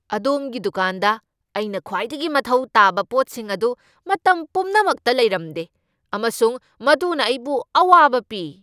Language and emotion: Manipuri, angry